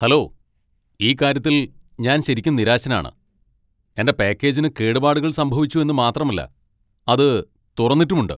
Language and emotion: Malayalam, angry